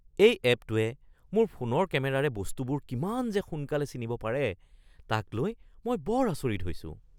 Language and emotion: Assamese, surprised